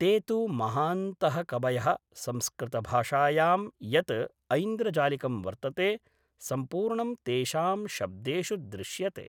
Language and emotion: Sanskrit, neutral